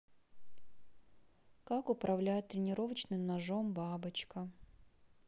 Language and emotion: Russian, neutral